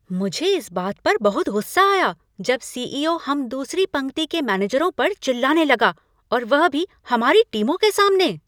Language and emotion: Hindi, angry